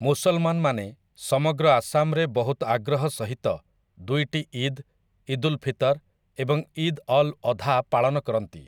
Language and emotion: Odia, neutral